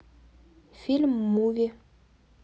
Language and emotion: Russian, neutral